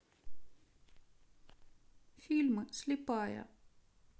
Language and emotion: Russian, sad